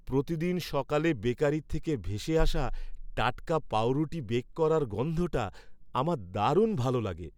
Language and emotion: Bengali, happy